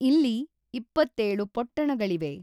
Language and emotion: Kannada, neutral